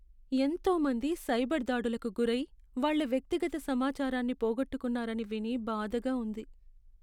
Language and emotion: Telugu, sad